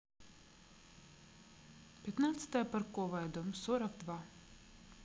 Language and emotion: Russian, neutral